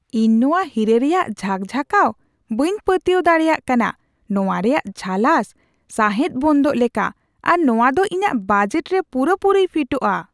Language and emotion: Santali, surprised